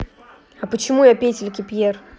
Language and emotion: Russian, angry